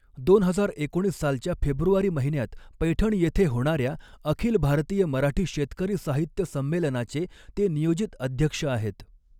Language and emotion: Marathi, neutral